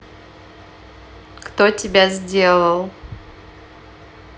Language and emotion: Russian, neutral